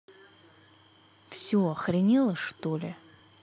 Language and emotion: Russian, angry